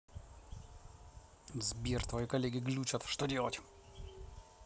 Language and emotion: Russian, angry